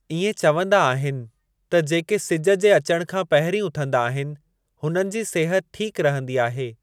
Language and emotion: Sindhi, neutral